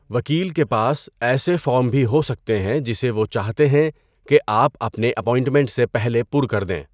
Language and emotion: Urdu, neutral